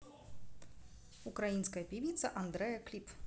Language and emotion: Russian, neutral